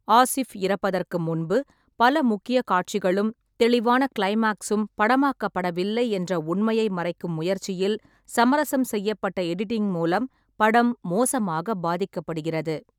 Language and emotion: Tamil, neutral